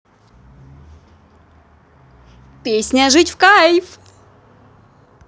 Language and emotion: Russian, positive